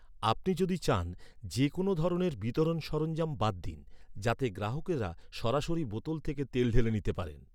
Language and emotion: Bengali, neutral